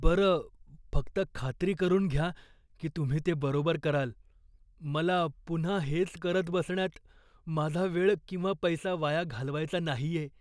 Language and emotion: Marathi, fearful